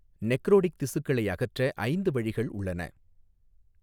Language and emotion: Tamil, neutral